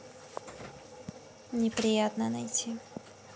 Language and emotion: Russian, neutral